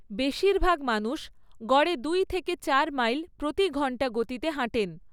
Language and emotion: Bengali, neutral